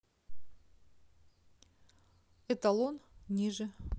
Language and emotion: Russian, neutral